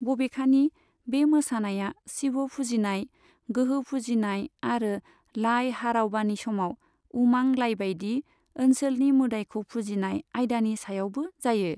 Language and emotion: Bodo, neutral